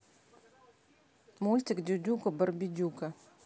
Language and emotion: Russian, neutral